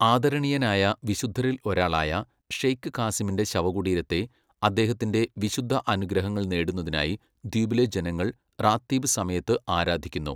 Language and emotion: Malayalam, neutral